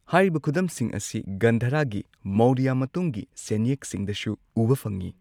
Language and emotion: Manipuri, neutral